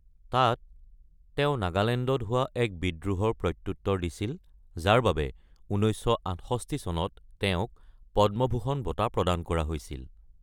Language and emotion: Assamese, neutral